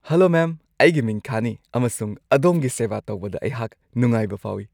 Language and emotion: Manipuri, happy